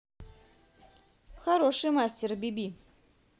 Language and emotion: Russian, positive